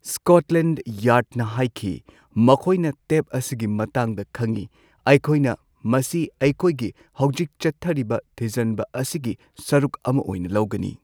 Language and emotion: Manipuri, neutral